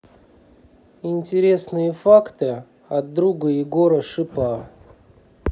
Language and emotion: Russian, neutral